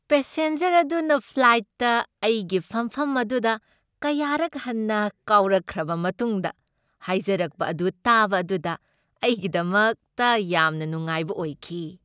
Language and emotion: Manipuri, happy